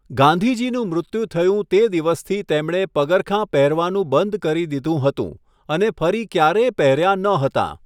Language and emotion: Gujarati, neutral